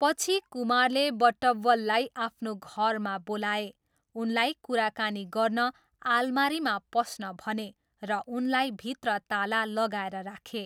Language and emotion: Nepali, neutral